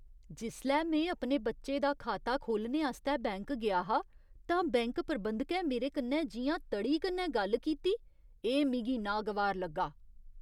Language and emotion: Dogri, disgusted